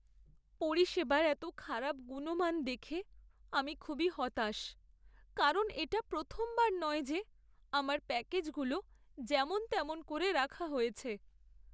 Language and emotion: Bengali, sad